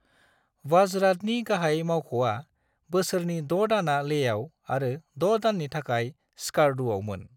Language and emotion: Bodo, neutral